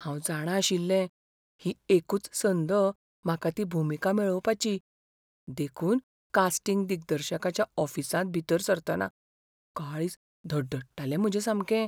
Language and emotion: Goan Konkani, fearful